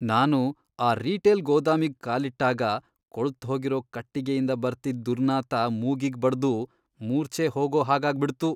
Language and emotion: Kannada, disgusted